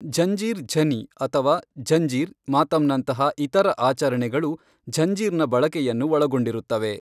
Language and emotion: Kannada, neutral